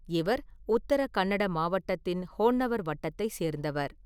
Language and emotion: Tamil, neutral